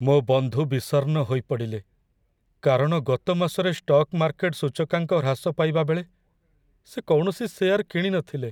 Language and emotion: Odia, sad